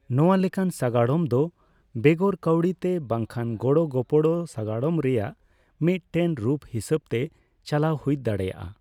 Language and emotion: Santali, neutral